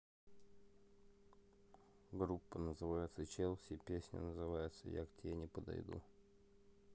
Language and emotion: Russian, neutral